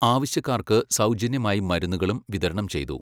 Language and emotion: Malayalam, neutral